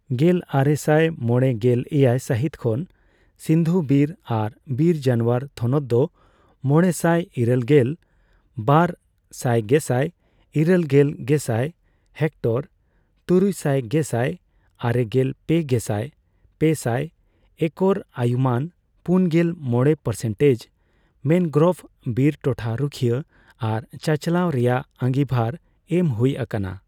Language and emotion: Santali, neutral